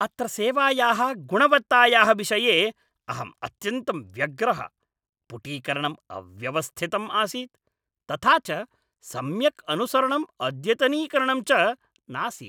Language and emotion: Sanskrit, angry